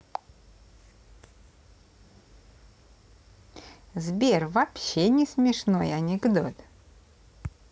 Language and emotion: Russian, positive